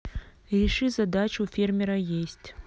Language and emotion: Russian, neutral